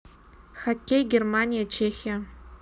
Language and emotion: Russian, neutral